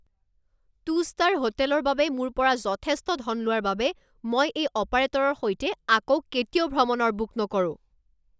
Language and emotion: Assamese, angry